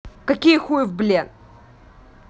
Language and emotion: Russian, angry